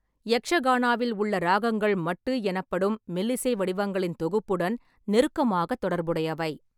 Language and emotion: Tamil, neutral